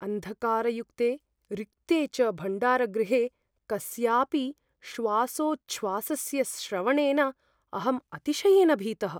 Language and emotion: Sanskrit, fearful